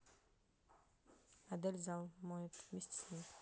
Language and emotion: Russian, neutral